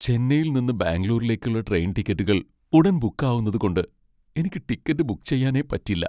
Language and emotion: Malayalam, sad